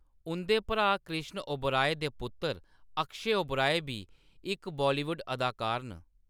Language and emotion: Dogri, neutral